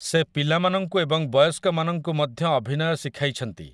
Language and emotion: Odia, neutral